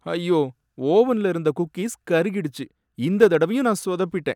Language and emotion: Tamil, sad